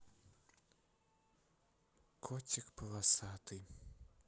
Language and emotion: Russian, sad